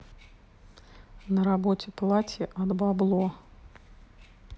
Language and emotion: Russian, neutral